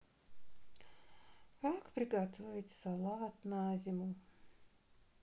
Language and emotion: Russian, sad